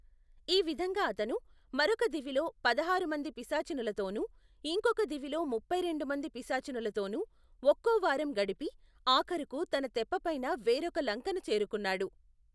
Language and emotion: Telugu, neutral